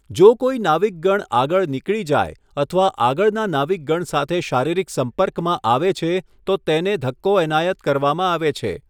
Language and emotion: Gujarati, neutral